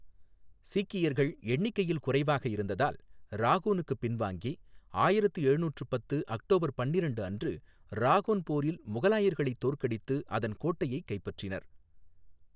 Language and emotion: Tamil, neutral